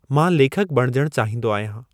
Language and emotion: Sindhi, neutral